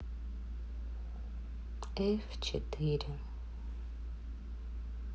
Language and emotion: Russian, sad